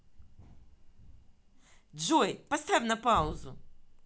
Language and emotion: Russian, angry